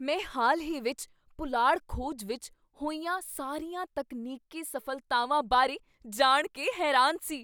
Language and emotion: Punjabi, surprised